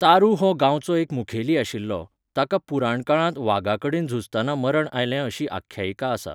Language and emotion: Goan Konkani, neutral